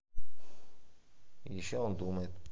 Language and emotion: Russian, neutral